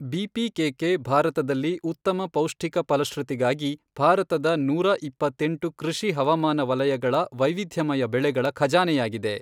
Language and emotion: Kannada, neutral